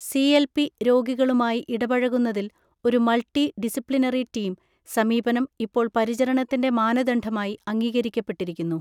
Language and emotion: Malayalam, neutral